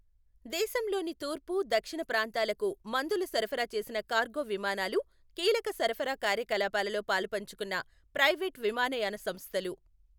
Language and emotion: Telugu, neutral